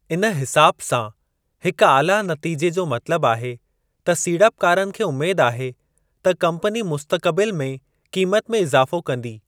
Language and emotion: Sindhi, neutral